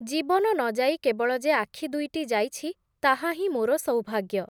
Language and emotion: Odia, neutral